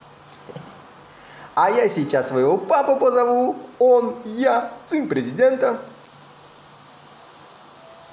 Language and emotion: Russian, positive